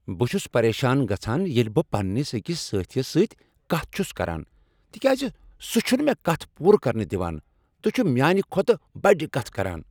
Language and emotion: Kashmiri, angry